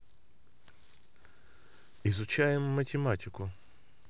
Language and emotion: Russian, neutral